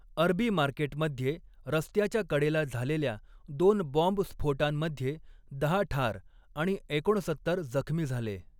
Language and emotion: Marathi, neutral